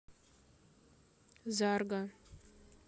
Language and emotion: Russian, neutral